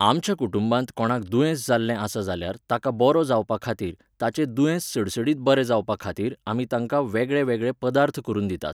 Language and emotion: Goan Konkani, neutral